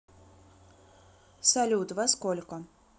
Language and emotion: Russian, neutral